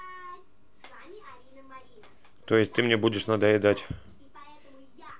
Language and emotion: Russian, neutral